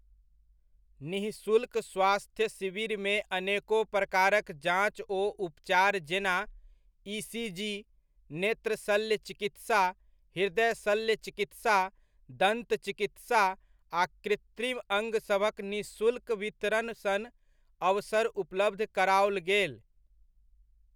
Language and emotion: Maithili, neutral